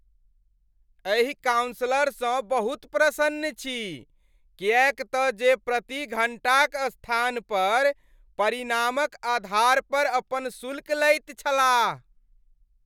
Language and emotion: Maithili, happy